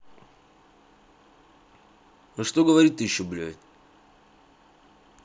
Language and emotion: Russian, angry